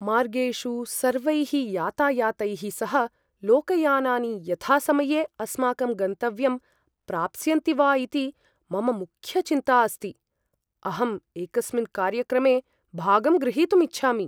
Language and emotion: Sanskrit, fearful